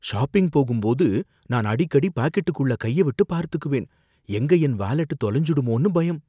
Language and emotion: Tamil, fearful